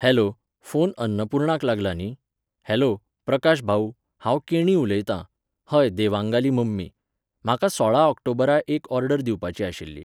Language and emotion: Goan Konkani, neutral